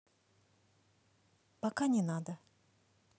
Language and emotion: Russian, neutral